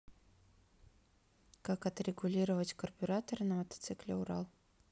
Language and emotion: Russian, neutral